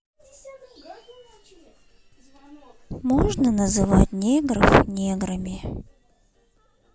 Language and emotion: Russian, sad